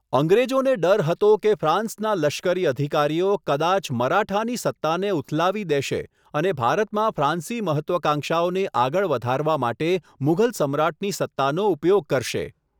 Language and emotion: Gujarati, neutral